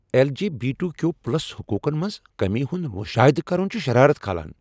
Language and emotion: Kashmiri, angry